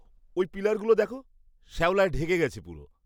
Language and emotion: Bengali, disgusted